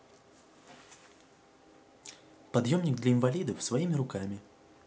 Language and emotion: Russian, neutral